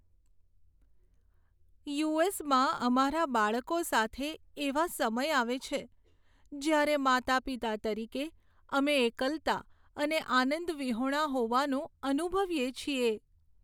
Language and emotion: Gujarati, sad